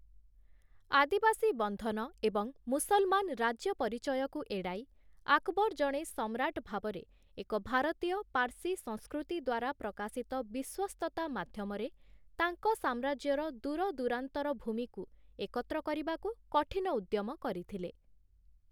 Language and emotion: Odia, neutral